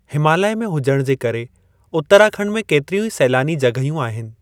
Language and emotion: Sindhi, neutral